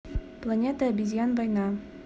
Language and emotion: Russian, neutral